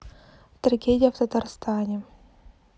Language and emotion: Russian, sad